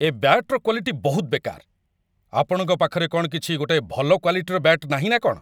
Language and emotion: Odia, angry